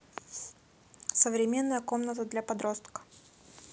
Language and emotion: Russian, neutral